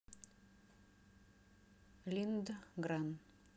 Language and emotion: Russian, neutral